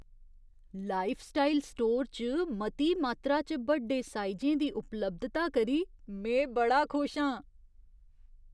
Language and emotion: Dogri, surprised